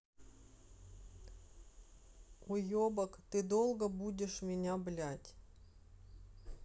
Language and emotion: Russian, angry